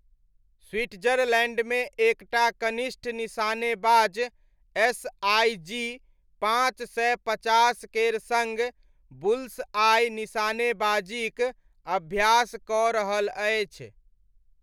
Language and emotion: Maithili, neutral